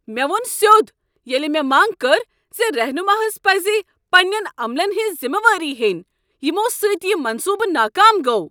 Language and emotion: Kashmiri, angry